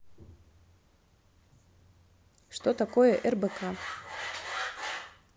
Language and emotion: Russian, neutral